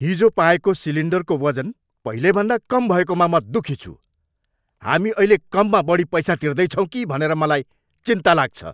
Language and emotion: Nepali, angry